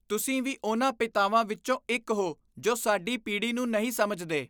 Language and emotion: Punjabi, disgusted